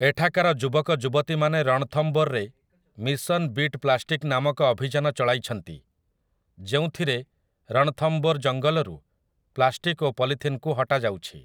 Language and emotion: Odia, neutral